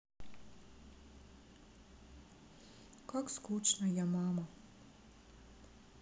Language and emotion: Russian, sad